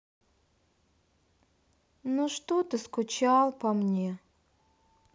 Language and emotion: Russian, sad